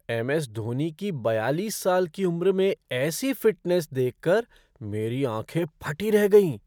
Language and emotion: Hindi, surprised